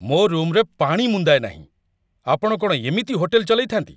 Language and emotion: Odia, angry